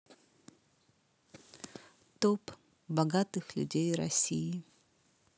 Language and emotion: Russian, neutral